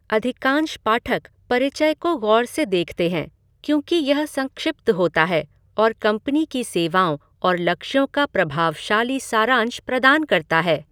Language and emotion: Hindi, neutral